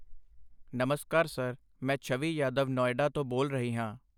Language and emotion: Punjabi, neutral